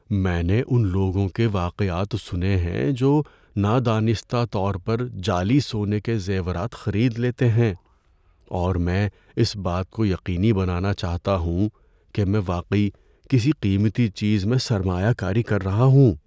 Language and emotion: Urdu, fearful